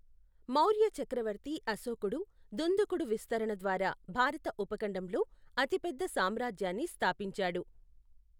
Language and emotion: Telugu, neutral